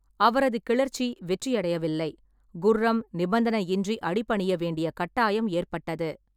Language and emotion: Tamil, neutral